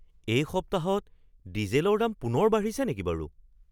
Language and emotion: Assamese, surprised